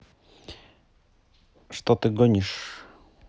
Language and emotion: Russian, neutral